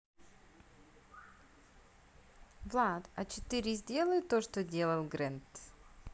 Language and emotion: Russian, neutral